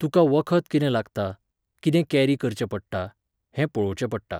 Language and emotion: Goan Konkani, neutral